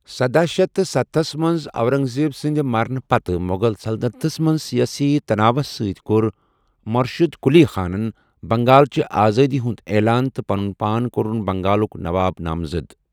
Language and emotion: Kashmiri, neutral